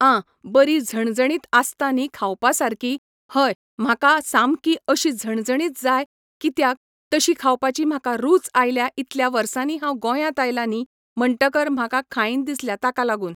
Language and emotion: Goan Konkani, neutral